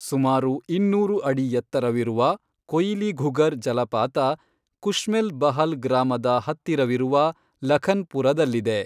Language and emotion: Kannada, neutral